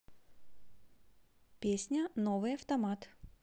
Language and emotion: Russian, positive